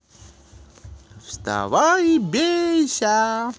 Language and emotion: Russian, positive